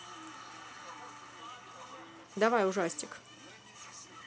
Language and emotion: Russian, neutral